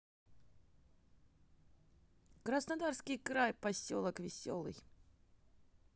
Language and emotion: Russian, positive